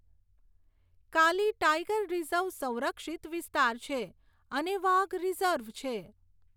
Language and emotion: Gujarati, neutral